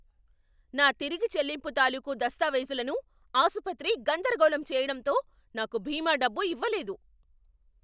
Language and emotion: Telugu, angry